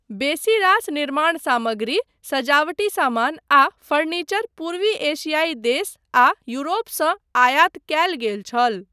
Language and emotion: Maithili, neutral